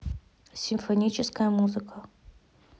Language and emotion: Russian, neutral